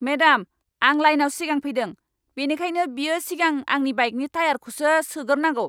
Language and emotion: Bodo, angry